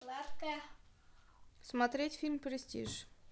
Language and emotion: Russian, neutral